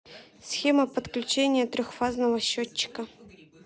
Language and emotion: Russian, neutral